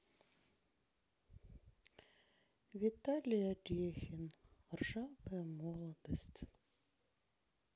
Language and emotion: Russian, sad